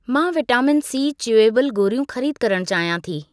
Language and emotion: Sindhi, neutral